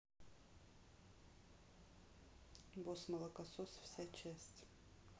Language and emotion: Russian, neutral